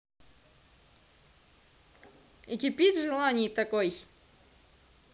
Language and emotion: Russian, positive